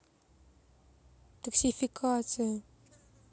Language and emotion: Russian, sad